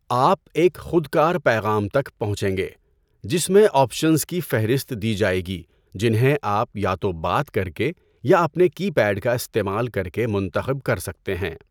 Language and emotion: Urdu, neutral